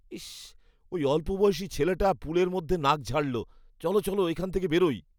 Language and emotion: Bengali, disgusted